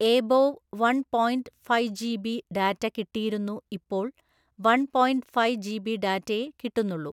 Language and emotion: Malayalam, neutral